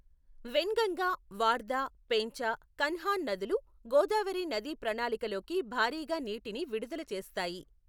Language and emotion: Telugu, neutral